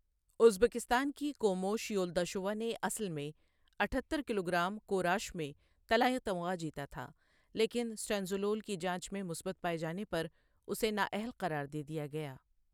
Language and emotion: Urdu, neutral